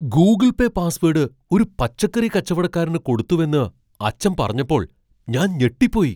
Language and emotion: Malayalam, surprised